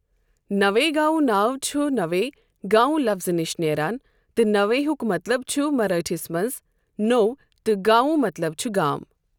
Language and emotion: Kashmiri, neutral